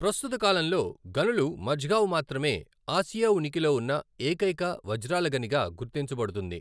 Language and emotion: Telugu, neutral